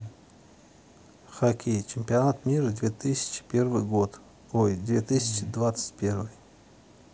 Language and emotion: Russian, neutral